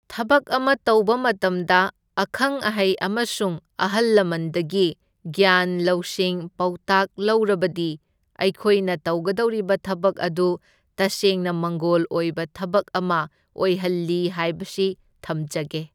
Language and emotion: Manipuri, neutral